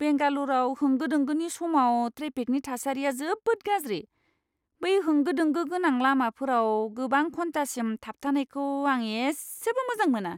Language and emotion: Bodo, disgusted